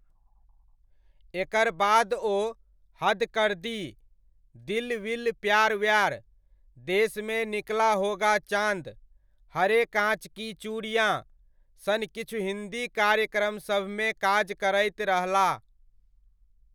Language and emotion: Maithili, neutral